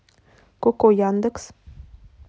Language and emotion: Russian, neutral